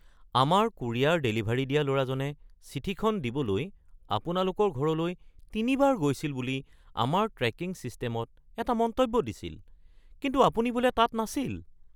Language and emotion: Assamese, surprised